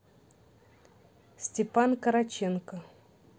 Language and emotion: Russian, neutral